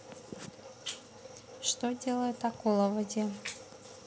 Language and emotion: Russian, neutral